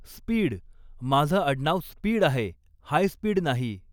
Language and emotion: Marathi, neutral